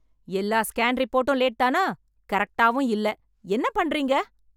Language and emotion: Tamil, angry